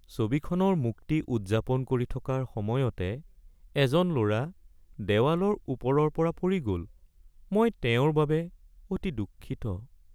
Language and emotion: Assamese, sad